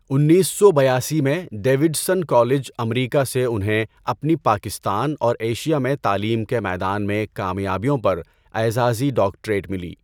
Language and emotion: Urdu, neutral